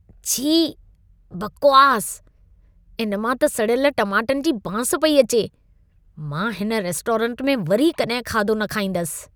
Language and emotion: Sindhi, disgusted